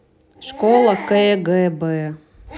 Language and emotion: Russian, neutral